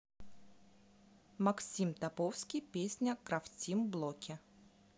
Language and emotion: Russian, neutral